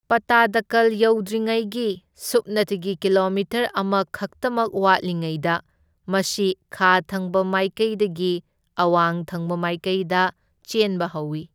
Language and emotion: Manipuri, neutral